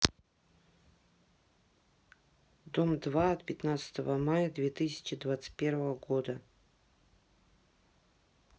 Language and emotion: Russian, neutral